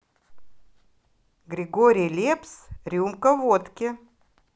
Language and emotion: Russian, positive